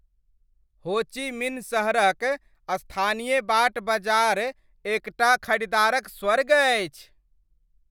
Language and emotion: Maithili, happy